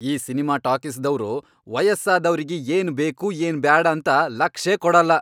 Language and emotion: Kannada, angry